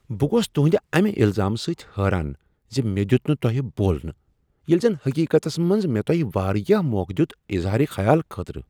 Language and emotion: Kashmiri, surprised